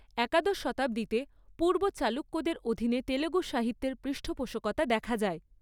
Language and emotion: Bengali, neutral